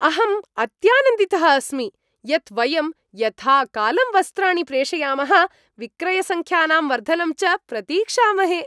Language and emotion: Sanskrit, happy